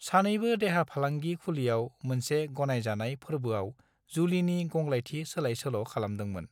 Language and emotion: Bodo, neutral